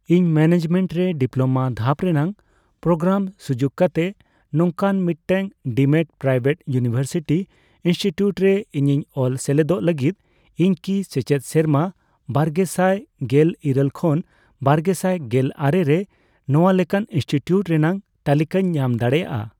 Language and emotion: Santali, neutral